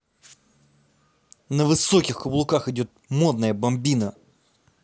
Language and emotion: Russian, neutral